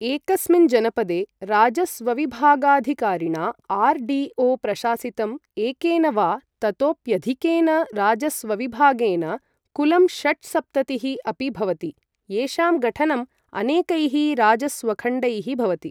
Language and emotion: Sanskrit, neutral